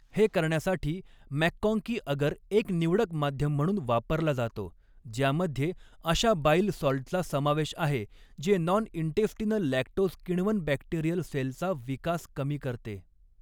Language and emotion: Marathi, neutral